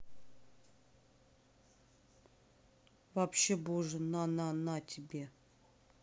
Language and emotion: Russian, neutral